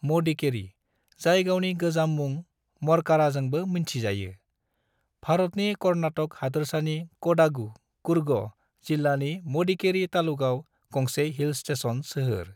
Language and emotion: Bodo, neutral